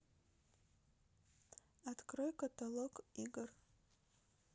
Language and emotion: Russian, neutral